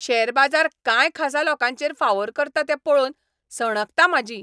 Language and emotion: Goan Konkani, angry